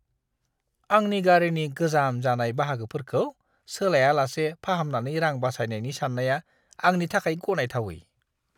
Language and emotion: Bodo, disgusted